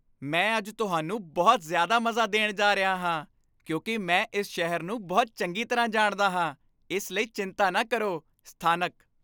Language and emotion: Punjabi, happy